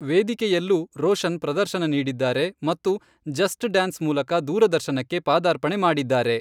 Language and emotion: Kannada, neutral